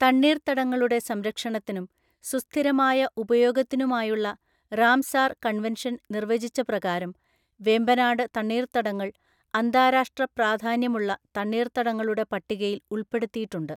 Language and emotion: Malayalam, neutral